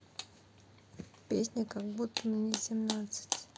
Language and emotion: Russian, sad